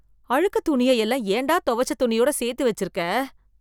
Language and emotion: Tamil, disgusted